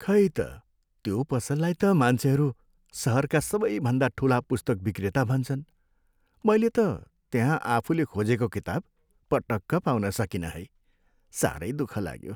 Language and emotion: Nepali, sad